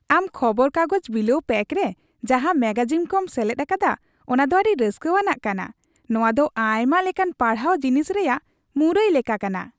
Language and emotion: Santali, happy